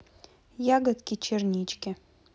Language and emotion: Russian, neutral